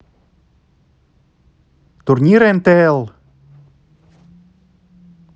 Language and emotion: Russian, neutral